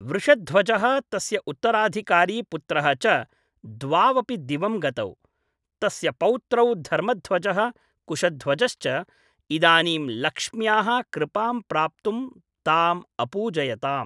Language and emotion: Sanskrit, neutral